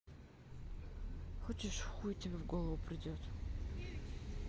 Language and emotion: Russian, neutral